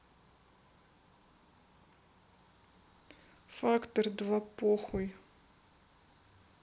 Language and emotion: Russian, neutral